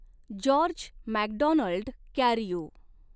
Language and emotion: Marathi, neutral